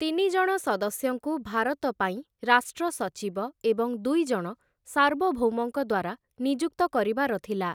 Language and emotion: Odia, neutral